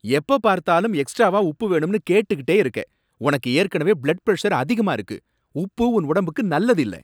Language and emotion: Tamil, angry